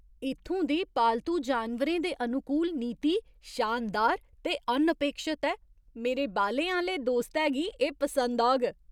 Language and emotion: Dogri, surprised